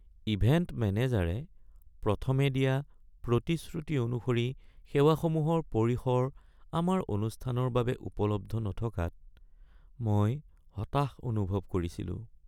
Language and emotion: Assamese, sad